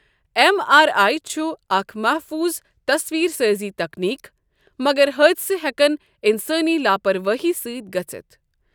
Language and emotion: Kashmiri, neutral